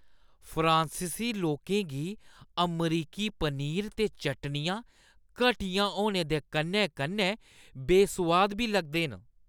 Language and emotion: Dogri, disgusted